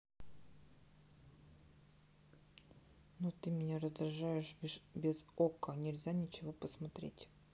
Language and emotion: Russian, neutral